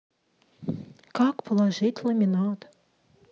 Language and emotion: Russian, sad